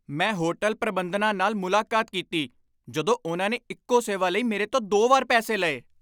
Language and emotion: Punjabi, angry